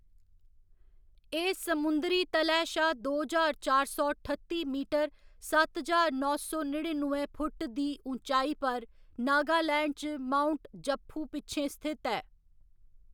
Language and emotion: Dogri, neutral